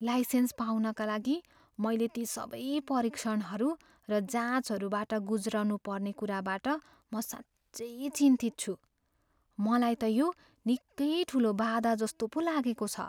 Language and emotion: Nepali, fearful